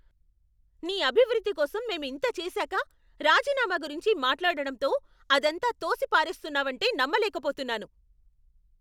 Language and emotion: Telugu, angry